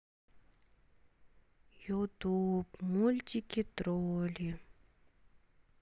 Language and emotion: Russian, sad